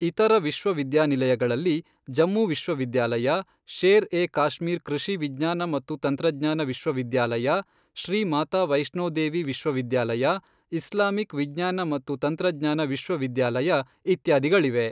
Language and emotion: Kannada, neutral